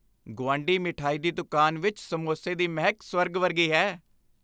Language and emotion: Punjabi, happy